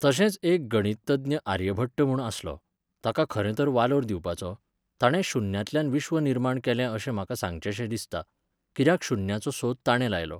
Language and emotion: Goan Konkani, neutral